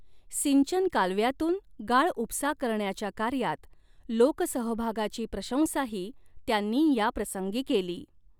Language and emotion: Marathi, neutral